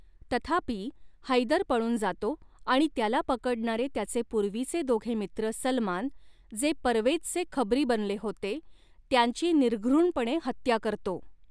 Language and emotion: Marathi, neutral